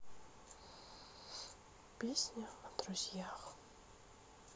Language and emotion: Russian, sad